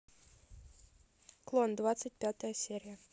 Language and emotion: Russian, neutral